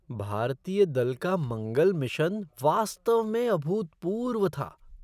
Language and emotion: Hindi, surprised